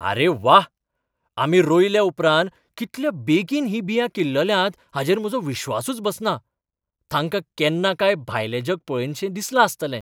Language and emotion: Goan Konkani, surprised